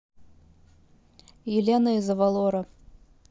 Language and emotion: Russian, neutral